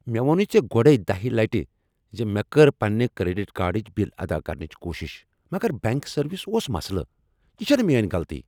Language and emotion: Kashmiri, angry